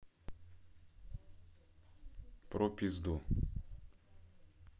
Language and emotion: Russian, neutral